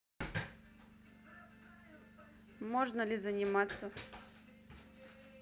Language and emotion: Russian, neutral